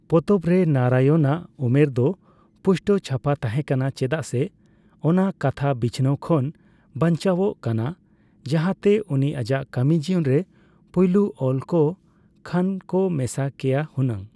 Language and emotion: Santali, neutral